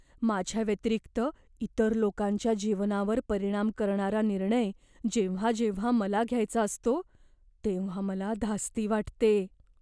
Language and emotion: Marathi, fearful